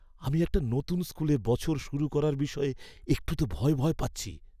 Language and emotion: Bengali, fearful